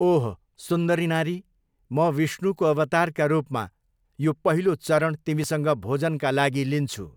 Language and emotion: Nepali, neutral